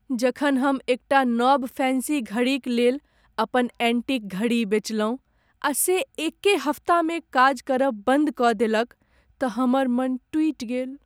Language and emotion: Maithili, sad